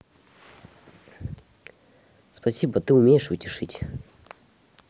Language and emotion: Russian, neutral